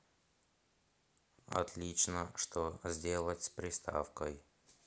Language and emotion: Russian, neutral